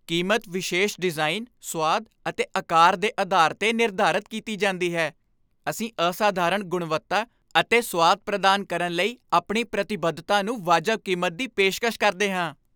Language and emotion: Punjabi, happy